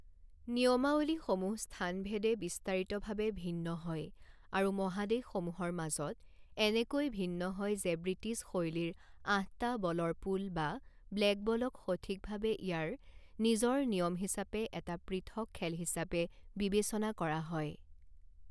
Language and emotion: Assamese, neutral